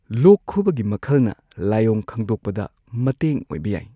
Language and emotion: Manipuri, neutral